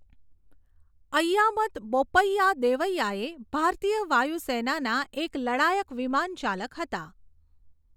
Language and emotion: Gujarati, neutral